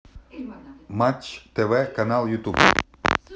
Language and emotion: Russian, positive